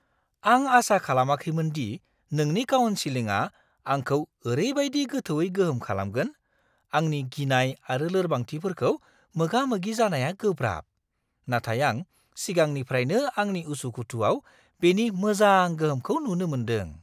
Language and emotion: Bodo, surprised